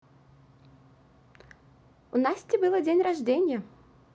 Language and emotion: Russian, positive